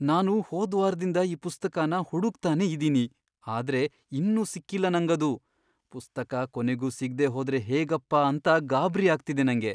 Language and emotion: Kannada, fearful